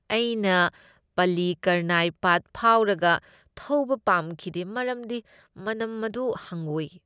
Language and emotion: Manipuri, disgusted